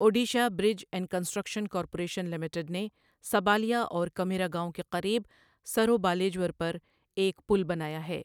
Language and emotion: Urdu, neutral